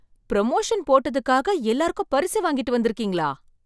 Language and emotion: Tamil, surprised